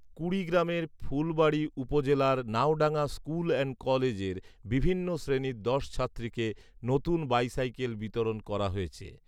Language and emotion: Bengali, neutral